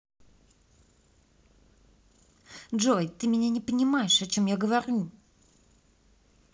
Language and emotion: Russian, angry